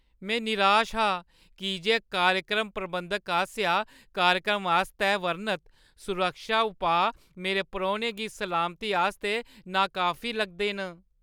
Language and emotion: Dogri, sad